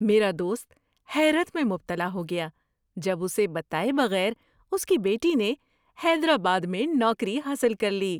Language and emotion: Urdu, surprised